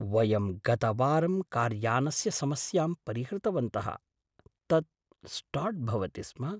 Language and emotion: Sanskrit, surprised